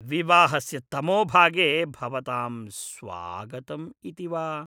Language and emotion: Sanskrit, disgusted